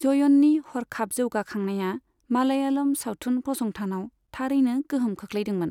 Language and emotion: Bodo, neutral